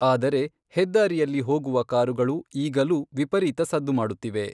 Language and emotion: Kannada, neutral